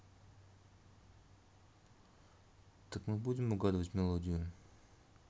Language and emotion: Russian, neutral